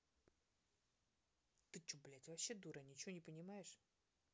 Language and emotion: Russian, angry